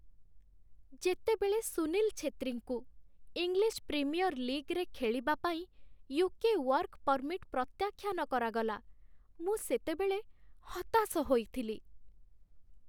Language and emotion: Odia, sad